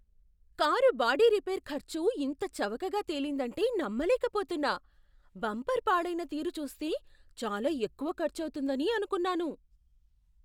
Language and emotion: Telugu, surprised